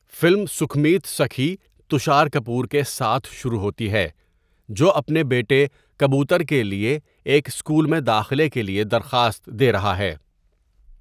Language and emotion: Urdu, neutral